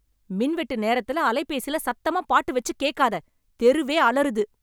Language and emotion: Tamil, angry